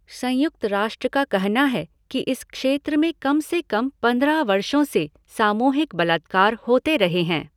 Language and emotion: Hindi, neutral